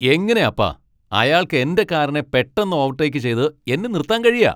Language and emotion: Malayalam, angry